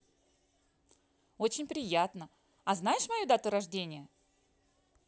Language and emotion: Russian, positive